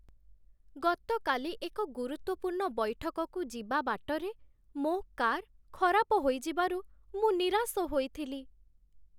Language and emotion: Odia, sad